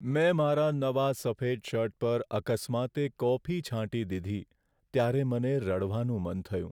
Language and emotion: Gujarati, sad